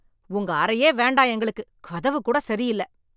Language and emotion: Tamil, angry